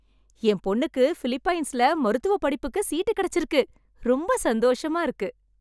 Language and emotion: Tamil, happy